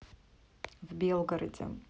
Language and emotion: Russian, neutral